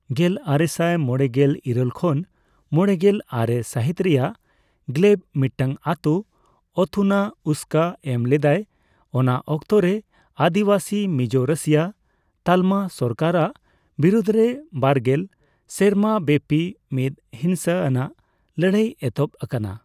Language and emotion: Santali, neutral